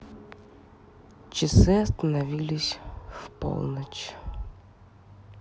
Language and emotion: Russian, sad